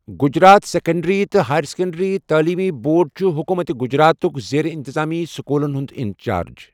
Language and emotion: Kashmiri, neutral